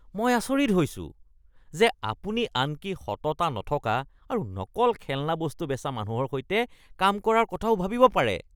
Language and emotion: Assamese, disgusted